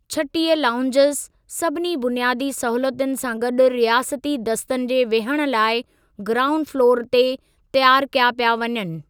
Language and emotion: Sindhi, neutral